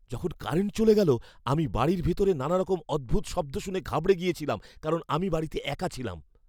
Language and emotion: Bengali, fearful